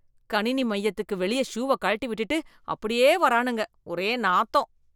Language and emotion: Tamil, disgusted